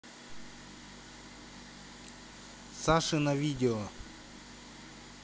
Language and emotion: Russian, neutral